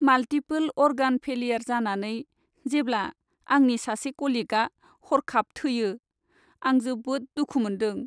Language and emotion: Bodo, sad